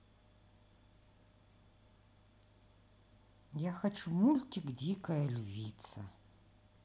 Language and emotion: Russian, neutral